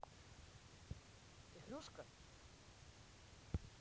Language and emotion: Russian, neutral